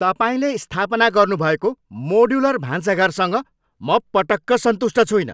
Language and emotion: Nepali, angry